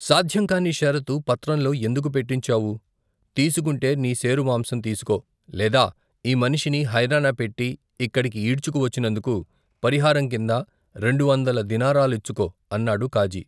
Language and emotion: Telugu, neutral